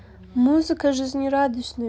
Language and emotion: Russian, neutral